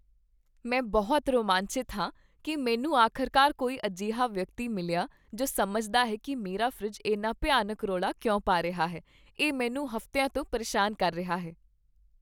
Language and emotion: Punjabi, happy